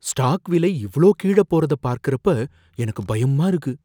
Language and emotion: Tamil, fearful